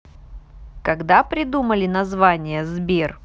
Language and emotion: Russian, positive